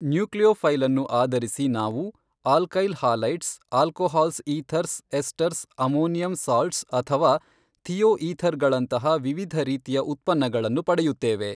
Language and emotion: Kannada, neutral